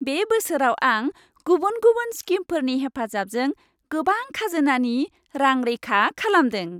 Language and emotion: Bodo, happy